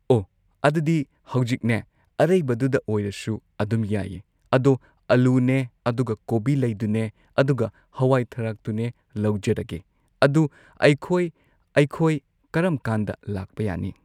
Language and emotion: Manipuri, neutral